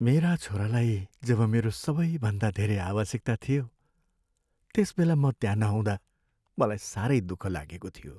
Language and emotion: Nepali, sad